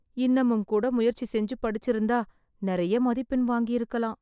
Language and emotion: Tamil, sad